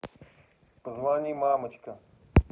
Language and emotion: Russian, neutral